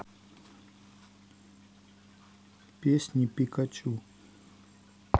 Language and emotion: Russian, neutral